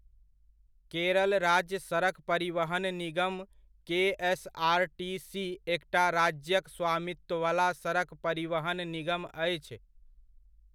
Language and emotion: Maithili, neutral